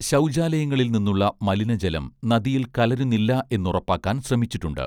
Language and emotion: Malayalam, neutral